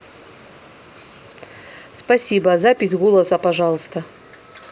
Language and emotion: Russian, neutral